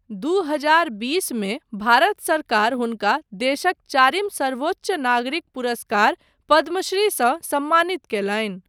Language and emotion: Maithili, neutral